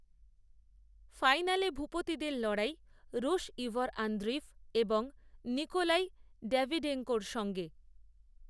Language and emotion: Bengali, neutral